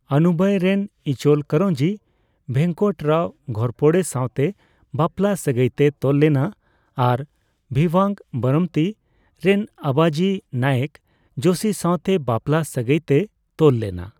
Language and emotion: Santali, neutral